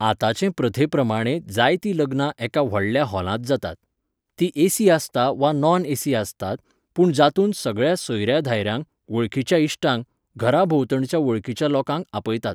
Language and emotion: Goan Konkani, neutral